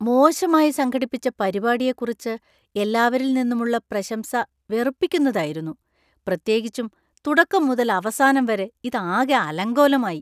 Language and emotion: Malayalam, disgusted